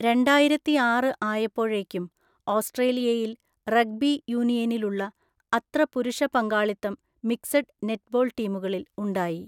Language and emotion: Malayalam, neutral